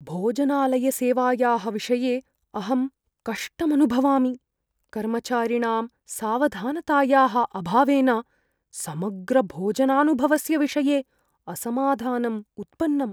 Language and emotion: Sanskrit, fearful